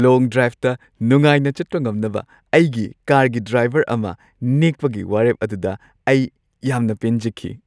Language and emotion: Manipuri, happy